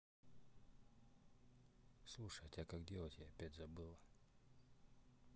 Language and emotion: Russian, neutral